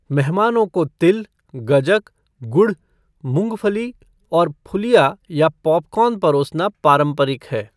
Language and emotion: Hindi, neutral